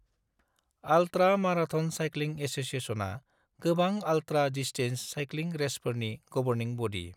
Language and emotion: Bodo, neutral